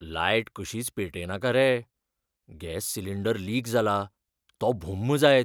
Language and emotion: Goan Konkani, fearful